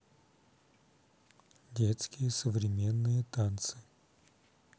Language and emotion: Russian, neutral